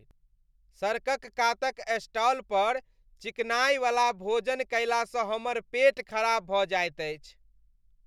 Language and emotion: Maithili, disgusted